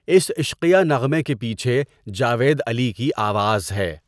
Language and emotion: Urdu, neutral